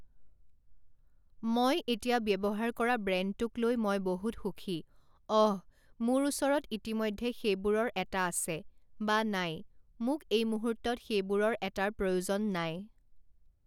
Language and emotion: Assamese, neutral